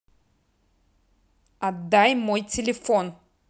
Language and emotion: Russian, angry